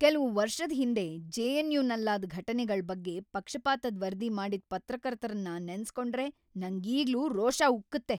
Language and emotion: Kannada, angry